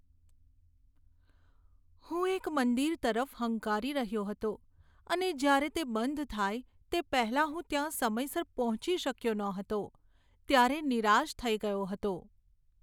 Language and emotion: Gujarati, sad